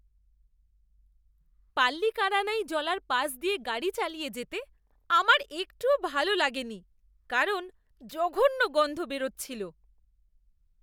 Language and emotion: Bengali, disgusted